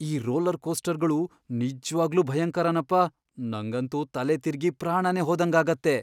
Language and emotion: Kannada, fearful